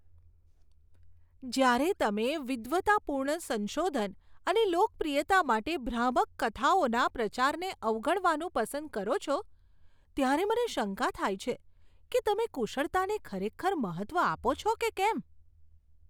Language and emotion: Gujarati, disgusted